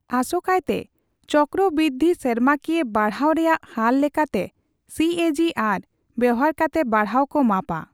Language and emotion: Santali, neutral